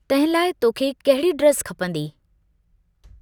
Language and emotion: Sindhi, neutral